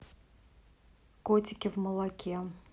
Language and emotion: Russian, neutral